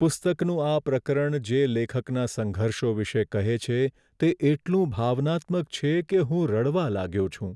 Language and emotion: Gujarati, sad